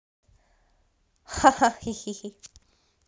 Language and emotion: Russian, positive